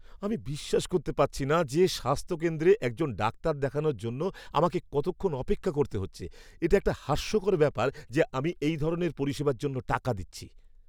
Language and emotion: Bengali, angry